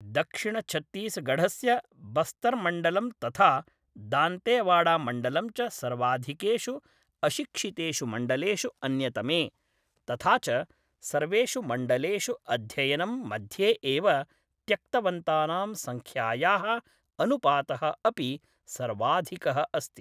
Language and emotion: Sanskrit, neutral